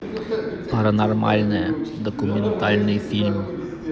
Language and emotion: Russian, neutral